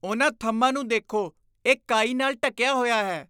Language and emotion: Punjabi, disgusted